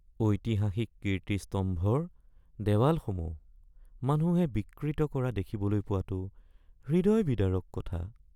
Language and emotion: Assamese, sad